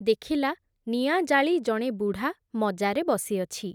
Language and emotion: Odia, neutral